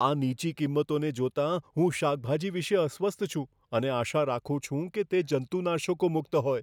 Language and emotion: Gujarati, fearful